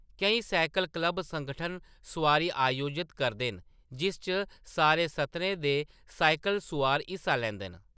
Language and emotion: Dogri, neutral